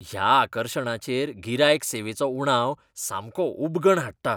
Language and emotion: Goan Konkani, disgusted